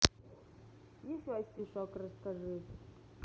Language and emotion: Russian, neutral